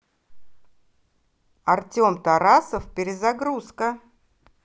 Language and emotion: Russian, positive